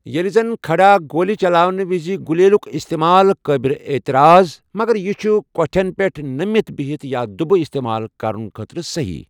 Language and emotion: Kashmiri, neutral